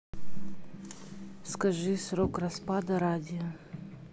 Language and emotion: Russian, neutral